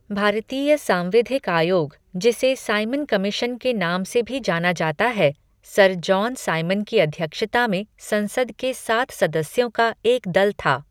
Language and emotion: Hindi, neutral